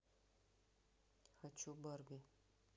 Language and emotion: Russian, neutral